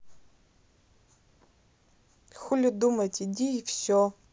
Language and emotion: Russian, neutral